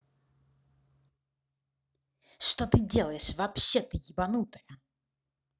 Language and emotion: Russian, angry